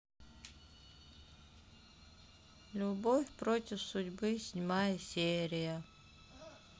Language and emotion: Russian, sad